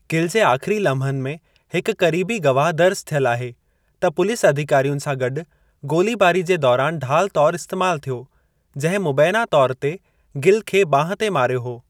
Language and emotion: Sindhi, neutral